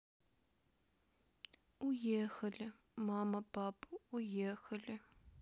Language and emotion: Russian, sad